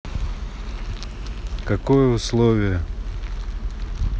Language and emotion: Russian, neutral